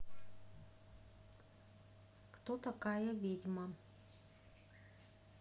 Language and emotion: Russian, neutral